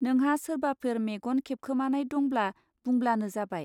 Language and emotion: Bodo, neutral